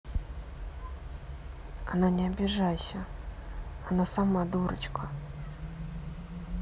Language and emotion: Russian, neutral